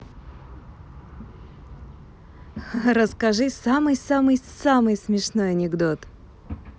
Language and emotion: Russian, positive